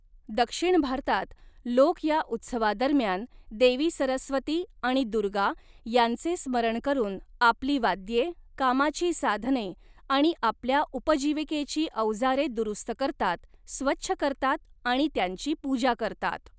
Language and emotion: Marathi, neutral